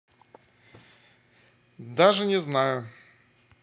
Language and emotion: Russian, neutral